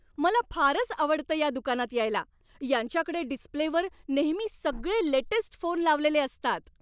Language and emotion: Marathi, happy